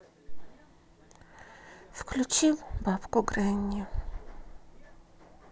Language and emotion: Russian, sad